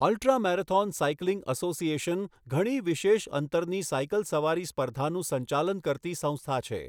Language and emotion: Gujarati, neutral